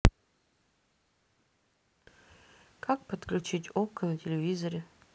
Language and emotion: Russian, neutral